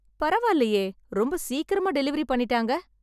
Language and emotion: Tamil, happy